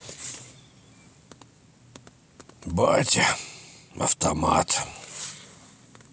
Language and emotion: Russian, sad